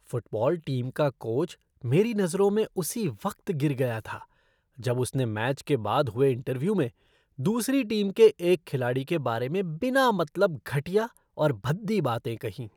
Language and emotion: Hindi, disgusted